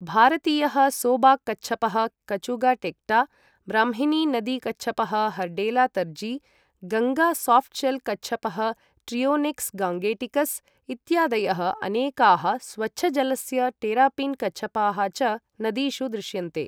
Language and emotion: Sanskrit, neutral